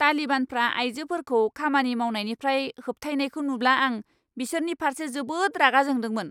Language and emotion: Bodo, angry